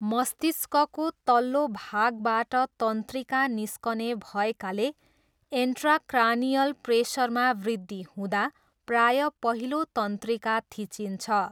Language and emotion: Nepali, neutral